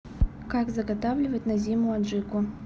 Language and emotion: Russian, neutral